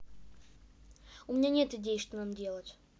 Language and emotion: Russian, neutral